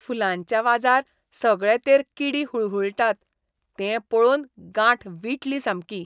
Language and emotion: Goan Konkani, disgusted